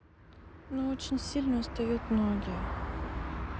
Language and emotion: Russian, sad